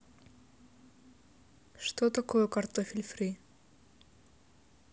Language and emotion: Russian, neutral